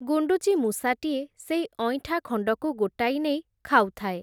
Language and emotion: Odia, neutral